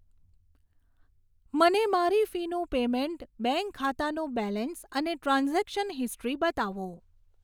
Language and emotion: Gujarati, neutral